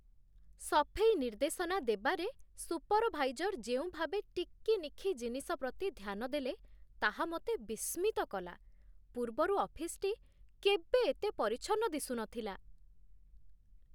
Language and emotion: Odia, surprised